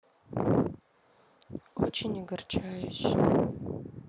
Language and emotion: Russian, sad